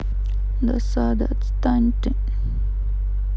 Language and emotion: Russian, sad